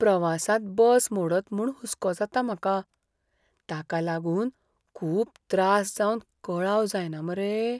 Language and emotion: Goan Konkani, fearful